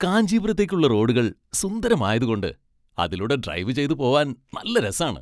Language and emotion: Malayalam, happy